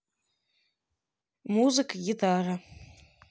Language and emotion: Russian, neutral